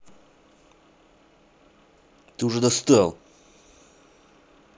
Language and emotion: Russian, angry